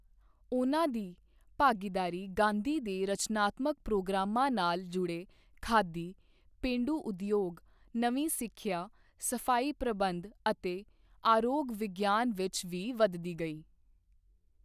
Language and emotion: Punjabi, neutral